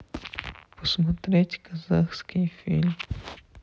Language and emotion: Russian, sad